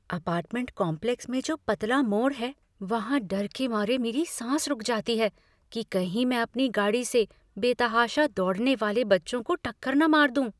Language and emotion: Hindi, fearful